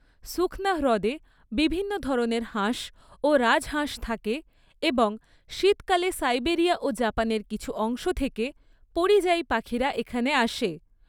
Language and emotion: Bengali, neutral